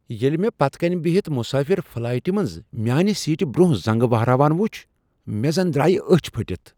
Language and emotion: Kashmiri, surprised